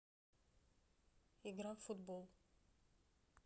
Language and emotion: Russian, neutral